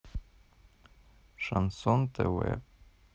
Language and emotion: Russian, neutral